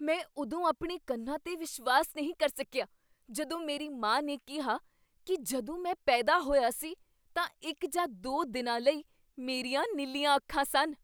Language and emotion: Punjabi, surprised